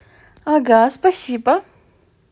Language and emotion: Russian, positive